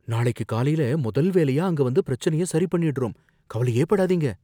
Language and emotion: Tamil, fearful